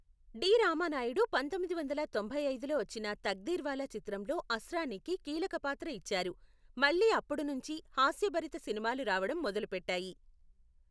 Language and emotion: Telugu, neutral